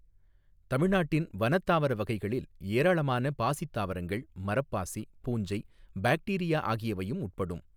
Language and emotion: Tamil, neutral